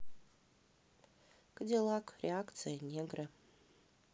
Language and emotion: Russian, neutral